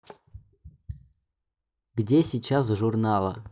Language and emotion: Russian, neutral